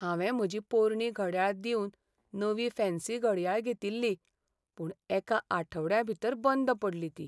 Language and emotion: Goan Konkani, sad